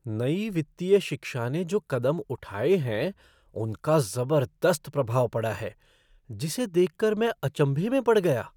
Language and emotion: Hindi, surprised